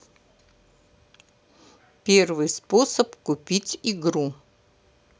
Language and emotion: Russian, neutral